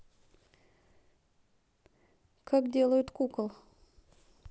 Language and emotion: Russian, neutral